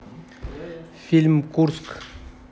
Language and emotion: Russian, neutral